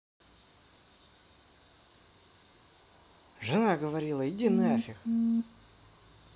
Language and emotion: Russian, angry